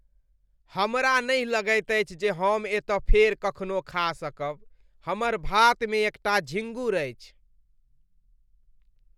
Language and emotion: Maithili, disgusted